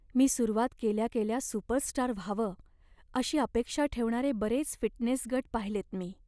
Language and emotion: Marathi, sad